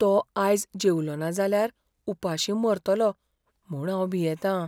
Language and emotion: Goan Konkani, fearful